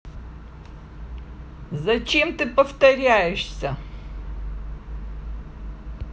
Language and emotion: Russian, angry